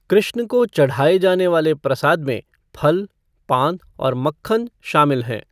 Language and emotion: Hindi, neutral